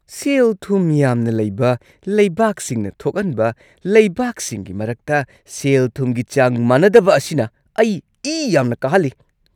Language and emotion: Manipuri, angry